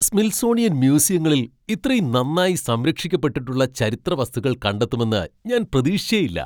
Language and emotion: Malayalam, surprised